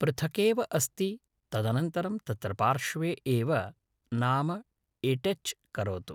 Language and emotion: Sanskrit, neutral